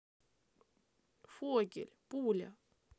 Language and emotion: Russian, sad